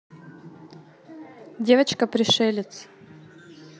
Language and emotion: Russian, neutral